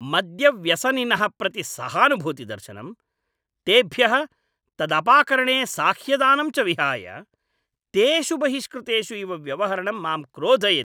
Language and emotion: Sanskrit, angry